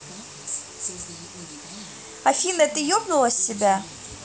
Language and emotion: Russian, angry